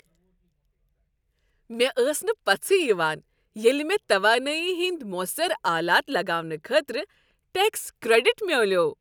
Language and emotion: Kashmiri, happy